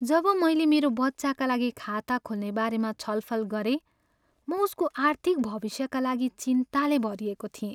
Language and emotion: Nepali, sad